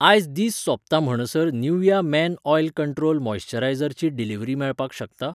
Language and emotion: Goan Konkani, neutral